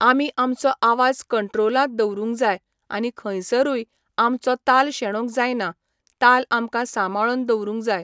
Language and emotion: Goan Konkani, neutral